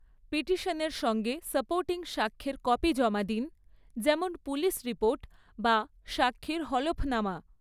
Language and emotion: Bengali, neutral